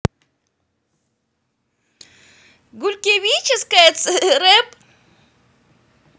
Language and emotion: Russian, positive